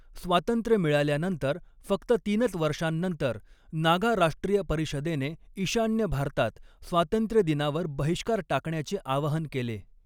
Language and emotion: Marathi, neutral